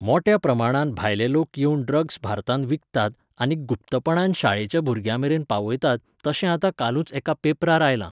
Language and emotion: Goan Konkani, neutral